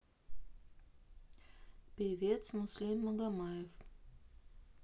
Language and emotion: Russian, neutral